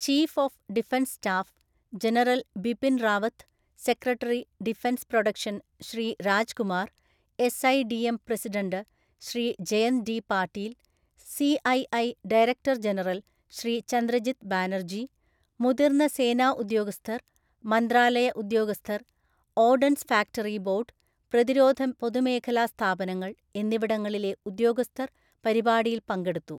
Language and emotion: Malayalam, neutral